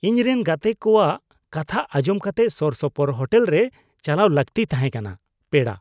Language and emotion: Santali, disgusted